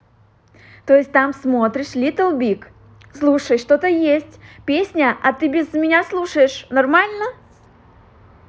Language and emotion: Russian, positive